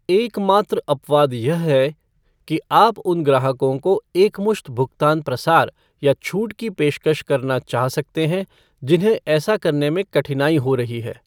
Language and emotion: Hindi, neutral